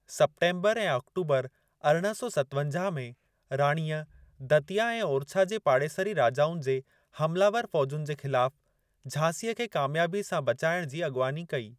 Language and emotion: Sindhi, neutral